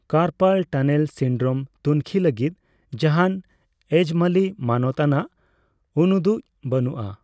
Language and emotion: Santali, neutral